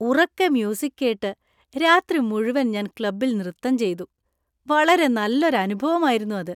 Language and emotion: Malayalam, happy